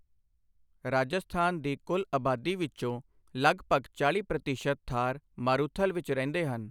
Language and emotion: Punjabi, neutral